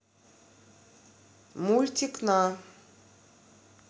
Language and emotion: Russian, neutral